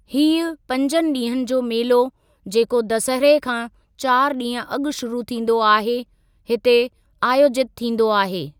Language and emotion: Sindhi, neutral